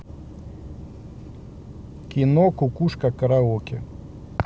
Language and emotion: Russian, neutral